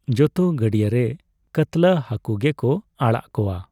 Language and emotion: Santali, neutral